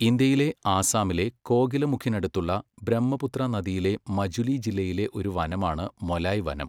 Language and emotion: Malayalam, neutral